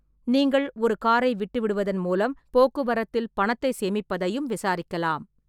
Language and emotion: Tamil, neutral